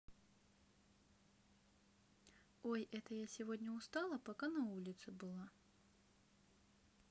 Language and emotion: Russian, neutral